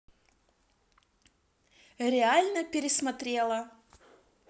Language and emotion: Russian, positive